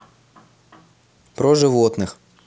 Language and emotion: Russian, neutral